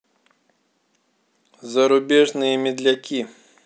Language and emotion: Russian, neutral